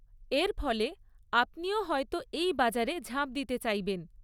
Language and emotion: Bengali, neutral